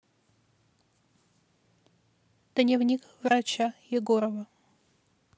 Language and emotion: Russian, neutral